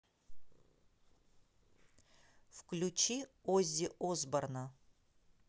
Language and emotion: Russian, neutral